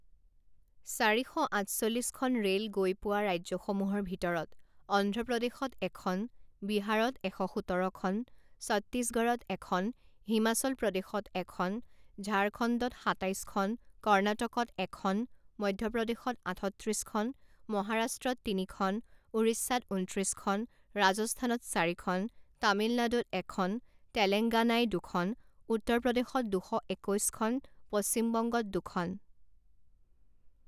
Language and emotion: Assamese, neutral